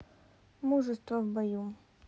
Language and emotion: Russian, neutral